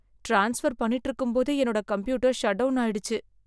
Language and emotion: Tamil, sad